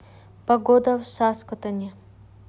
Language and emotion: Russian, neutral